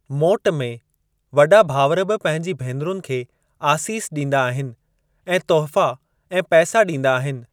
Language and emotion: Sindhi, neutral